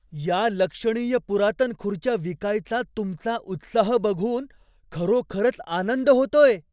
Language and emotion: Marathi, surprised